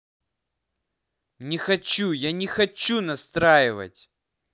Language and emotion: Russian, angry